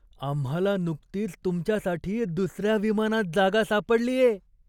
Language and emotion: Marathi, surprised